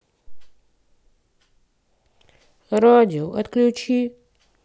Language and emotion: Russian, sad